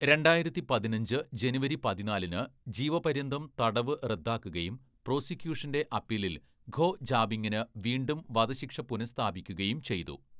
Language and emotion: Malayalam, neutral